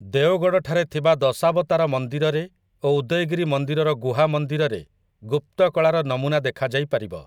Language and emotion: Odia, neutral